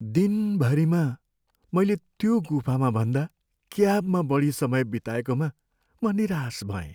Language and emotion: Nepali, sad